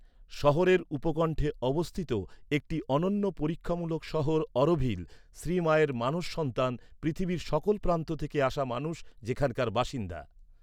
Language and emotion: Bengali, neutral